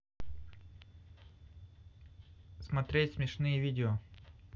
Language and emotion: Russian, neutral